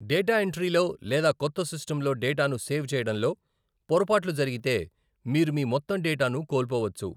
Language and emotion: Telugu, neutral